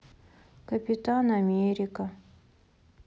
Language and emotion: Russian, sad